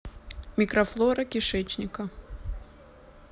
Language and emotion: Russian, neutral